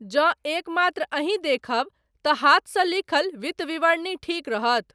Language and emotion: Maithili, neutral